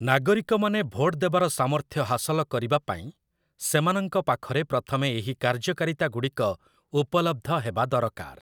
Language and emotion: Odia, neutral